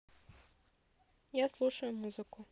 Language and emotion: Russian, neutral